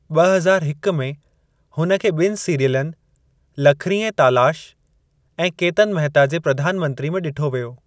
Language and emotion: Sindhi, neutral